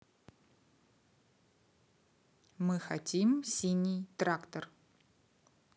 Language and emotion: Russian, neutral